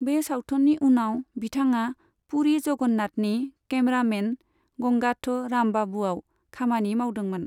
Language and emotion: Bodo, neutral